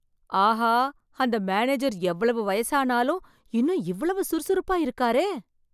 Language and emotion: Tamil, surprised